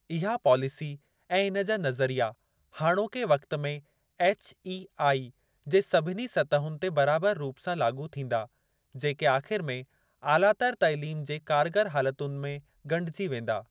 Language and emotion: Sindhi, neutral